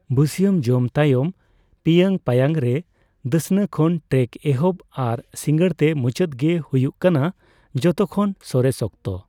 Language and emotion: Santali, neutral